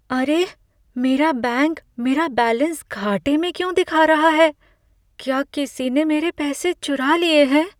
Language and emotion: Hindi, fearful